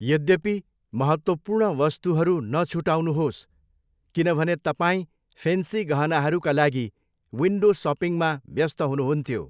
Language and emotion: Nepali, neutral